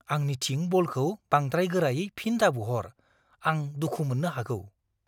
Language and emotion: Bodo, fearful